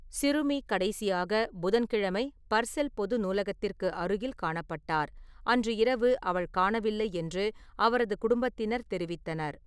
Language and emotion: Tamil, neutral